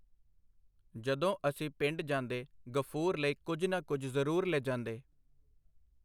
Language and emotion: Punjabi, neutral